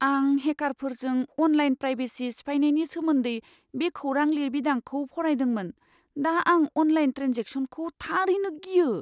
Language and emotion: Bodo, fearful